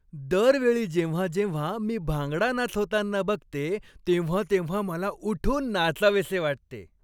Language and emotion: Marathi, happy